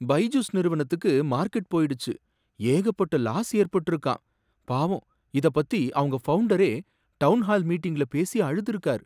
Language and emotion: Tamil, sad